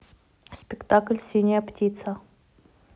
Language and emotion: Russian, neutral